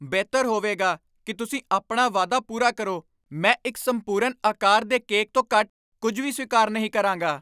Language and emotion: Punjabi, angry